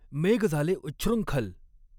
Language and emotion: Marathi, neutral